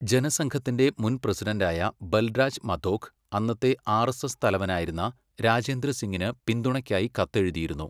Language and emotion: Malayalam, neutral